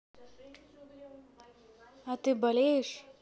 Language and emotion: Russian, neutral